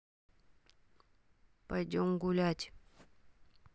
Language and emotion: Russian, neutral